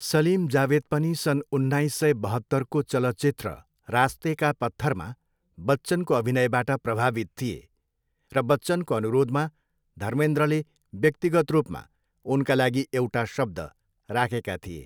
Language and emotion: Nepali, neutral